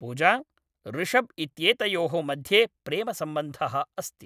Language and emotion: Sanskrit, neutral